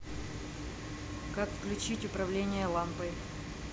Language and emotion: Russian, neutral